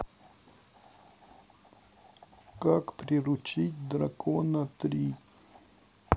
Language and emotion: Russian, sad